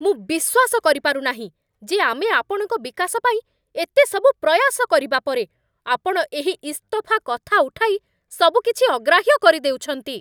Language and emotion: Odia, angry